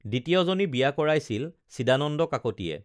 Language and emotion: Assamese, neutral